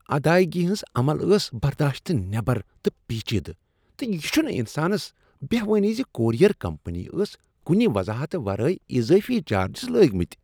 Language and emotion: Kashmiri, disgusted